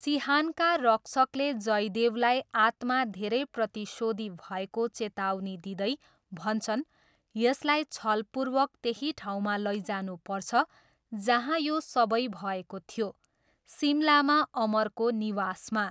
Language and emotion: Nepali, neutral